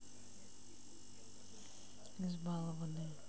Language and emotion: Russian, neutral